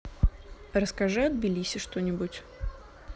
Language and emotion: Russian, neutral